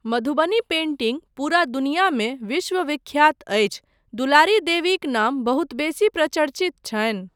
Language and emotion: Maithili, neutral